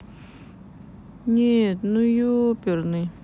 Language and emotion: Russian, sad